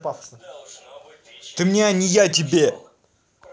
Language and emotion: Russian, angry